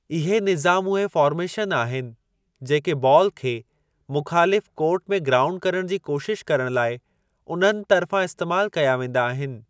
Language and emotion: Sindhi, neutral